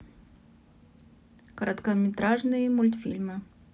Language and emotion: Russian, neutral